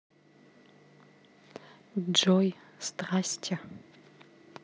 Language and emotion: Russian, neutral